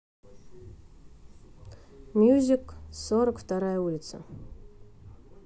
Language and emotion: Russian, neutral